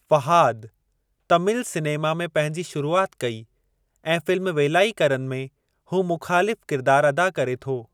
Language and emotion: Sindhi, neutral